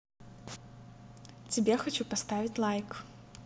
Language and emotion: Russian, positive